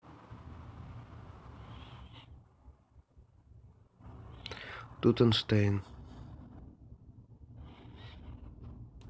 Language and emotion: Russian, neutral